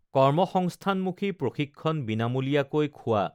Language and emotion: Assamese, neutral